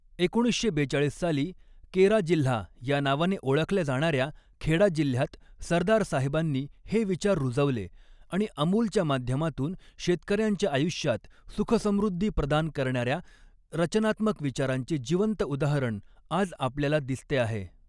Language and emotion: Marathi, neutral